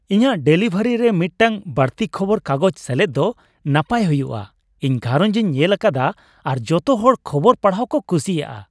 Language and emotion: Santali, happy